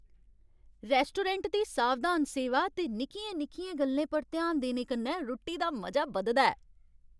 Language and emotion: Dogri, happy